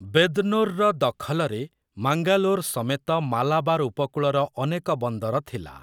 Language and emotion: Odia, neutral